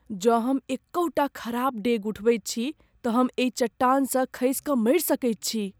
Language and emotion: Maithili, fearful